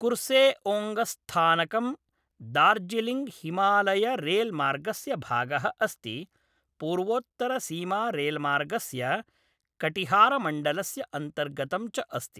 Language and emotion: Sanskrit, neutral